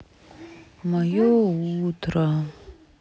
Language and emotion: Russian, sad